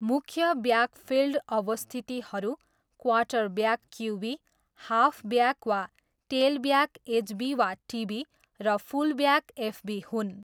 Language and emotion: Nepali, neutral